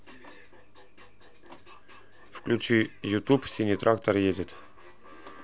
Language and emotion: Russian, neutral